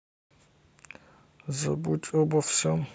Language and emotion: Russian, sad